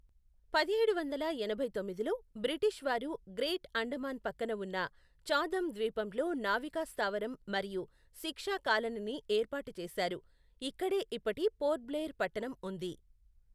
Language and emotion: Telugu, neutral